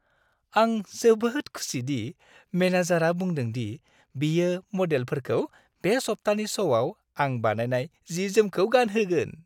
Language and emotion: Bodo, happy